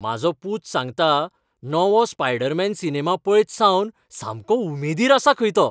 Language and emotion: Goan Konkani, happy